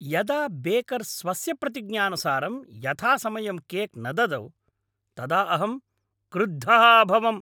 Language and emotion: Sanskrit, angry